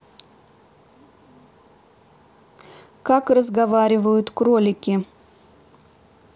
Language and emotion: Russian, neutral